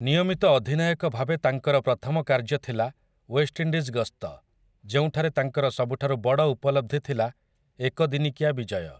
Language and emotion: Odia, neutral